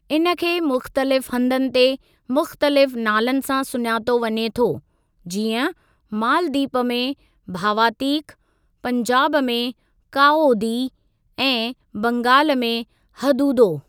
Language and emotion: Sindhi, neutral